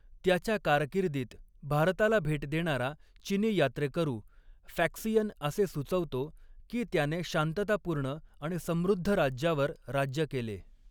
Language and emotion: Marathi, neutral